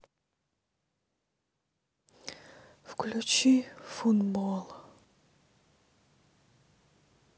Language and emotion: Russian, sad